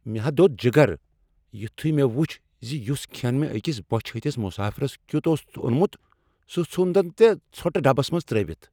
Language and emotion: Kashmiri, angry